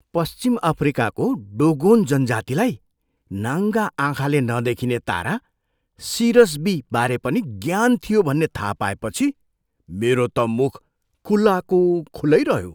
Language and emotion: Nepali, surprised